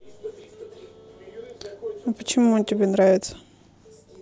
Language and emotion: Russian, neutral